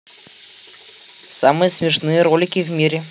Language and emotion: Russian, positive